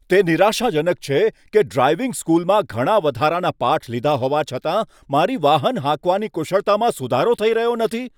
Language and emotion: Gujarati, angry